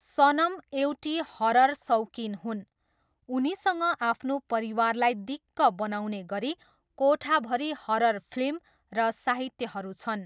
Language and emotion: Nepali, neutral